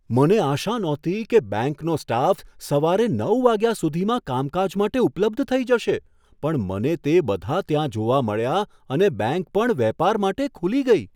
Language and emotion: Gujarati, surprised